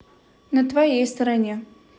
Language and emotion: Russian, neutral